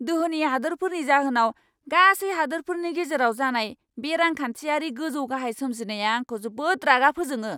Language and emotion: Bodo, angry